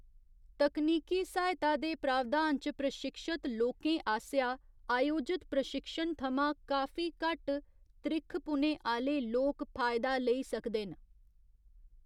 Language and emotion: Dogri, neutral